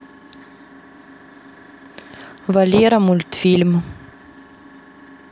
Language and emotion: Russian, neutral